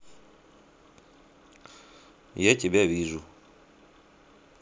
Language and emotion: Russian, neutral